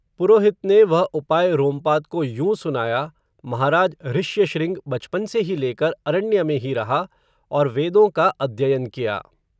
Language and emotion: Hindi, neutral